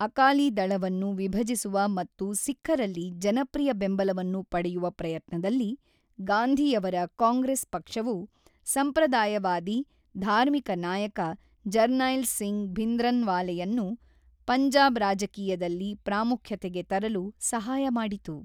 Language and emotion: Kannada, neutral